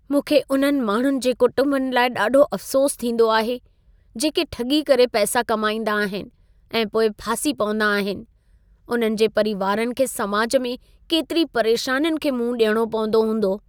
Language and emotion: Sindhi, sad